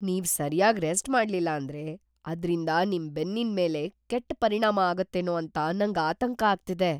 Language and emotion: Kannada, fearful